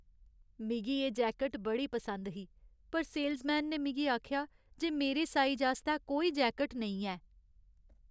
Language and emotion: Dogri, sad